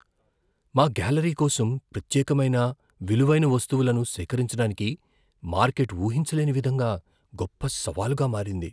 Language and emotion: Telugu, fearful